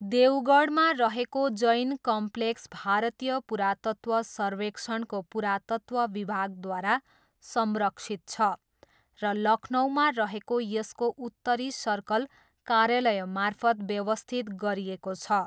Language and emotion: Nepali, neutral